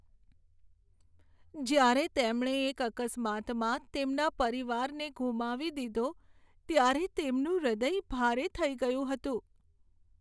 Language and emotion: Gujarati, sad